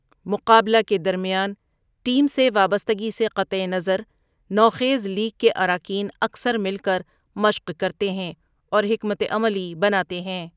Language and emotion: Urdu, neutral